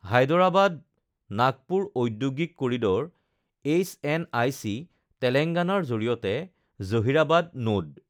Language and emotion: Assamese, neutral